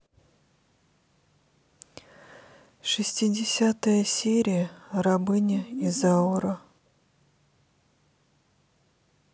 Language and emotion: Russian, sad